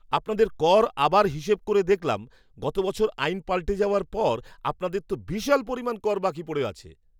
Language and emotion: Bengali, surprised